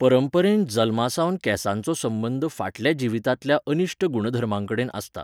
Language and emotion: Goan Konkani, neutral